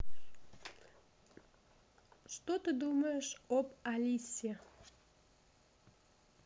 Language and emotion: Russian, neutral